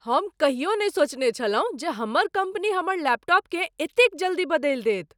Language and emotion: Maithili, surprised